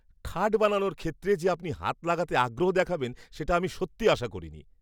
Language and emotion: Bengali, surprised